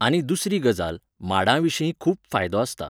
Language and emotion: Goan Konkani, neutral